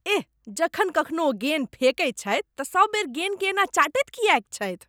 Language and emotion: Maithili, disgusted